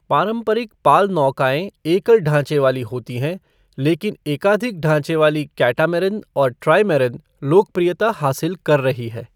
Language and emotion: Hindi, neutral